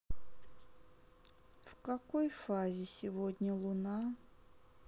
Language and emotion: Russian, sad